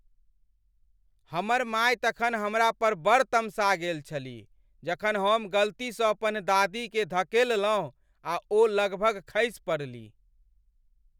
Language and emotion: Maithili, angry